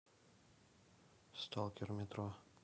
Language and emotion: Russian, neutral